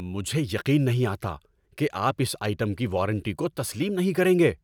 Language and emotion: Urdu, angry